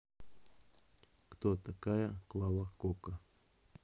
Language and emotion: Russian, neutral